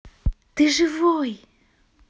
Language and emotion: Russian, positive